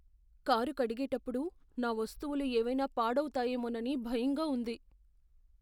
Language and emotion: Telugu, fearful